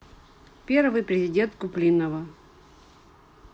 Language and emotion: Russian, neutral